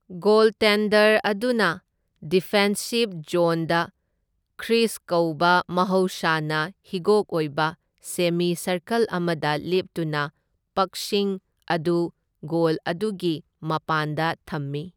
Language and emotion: Manipuri, neutral